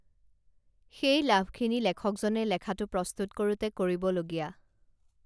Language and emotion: Assamese, neutral